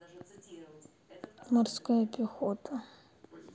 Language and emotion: Russian, sad